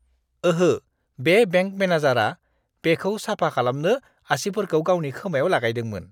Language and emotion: Bodo, disgusted